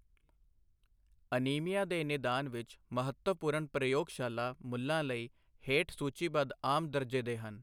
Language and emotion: Punjabi, neutral